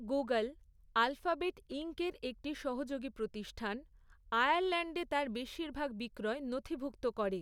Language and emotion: Bengali, neutral